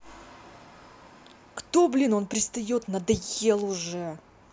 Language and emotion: Russian, angry